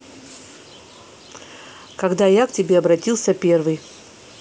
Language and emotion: Russian, neutral